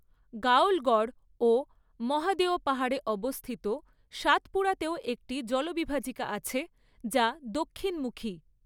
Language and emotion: Bengali, neutral